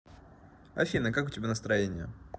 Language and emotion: Russian, neutral